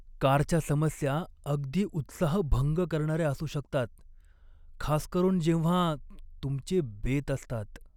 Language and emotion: Marathi, sad